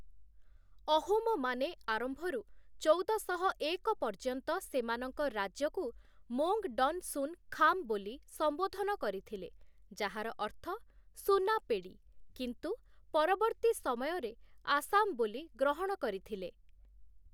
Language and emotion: Odia, neutral